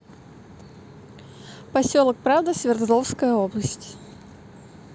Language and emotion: Russian, neutral